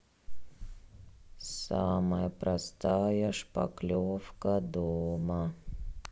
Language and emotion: Russian, sad